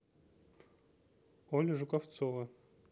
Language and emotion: Russian, neutral